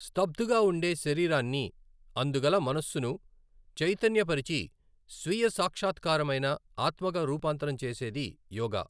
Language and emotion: Telugu, neutral